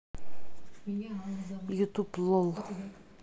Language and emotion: Russian, neutral